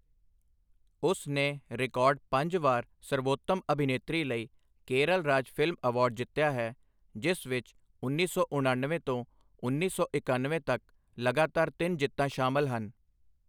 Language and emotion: Punjabi, neutral